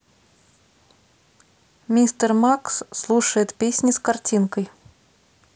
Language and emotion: Russian, neutral